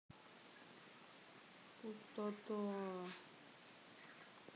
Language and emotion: Russian, sad